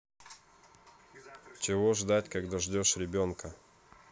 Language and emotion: Russian, neutral